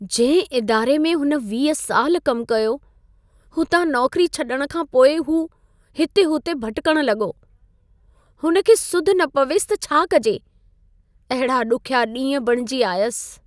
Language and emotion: Sindhi, sad